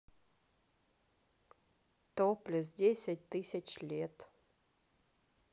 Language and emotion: Russian, neutral